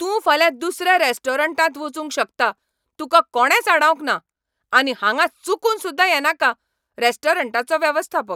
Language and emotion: Goan Konkani, angry